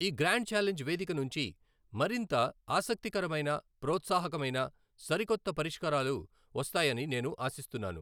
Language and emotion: Telugu, neutral